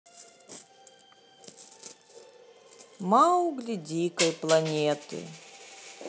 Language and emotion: Russian, neutral